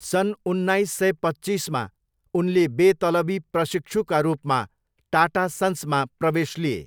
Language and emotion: Nepali, neutral